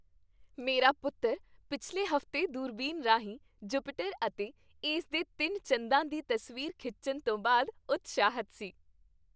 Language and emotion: Punjabi, happy